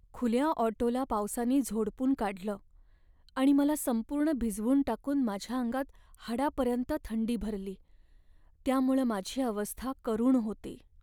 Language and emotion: Marathi, sad